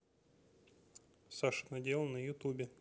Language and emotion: Russian, neutral